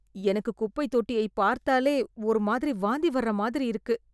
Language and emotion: Tamil, disgusted